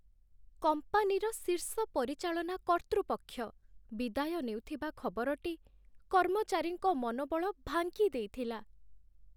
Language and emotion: Odia, sad